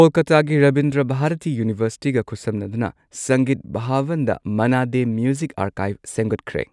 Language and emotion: Manipuri, neutral